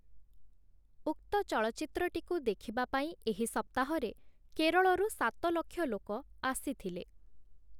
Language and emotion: Odia, neutral